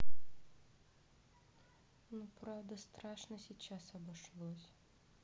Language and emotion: Russian, sad